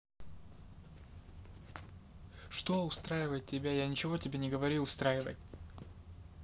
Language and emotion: Russian, neutral